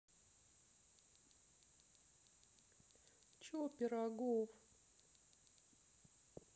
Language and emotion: Russian, sad